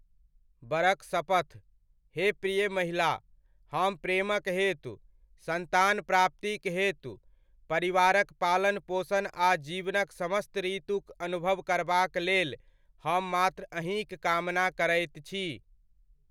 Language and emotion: Maithili, neutral